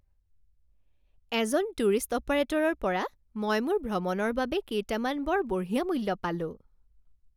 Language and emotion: Assamese, happy